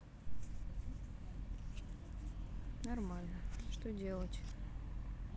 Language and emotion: Russian, neutral